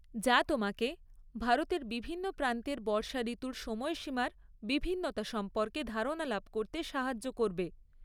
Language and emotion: Bengali, neutral